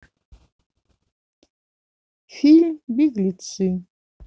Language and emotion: Russian, neutral